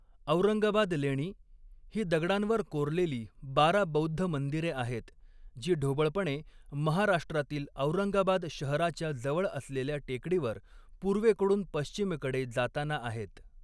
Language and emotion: Marathi, neutral